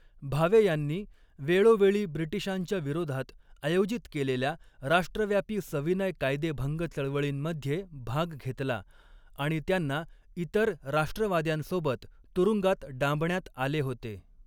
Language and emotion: Marathi, neutral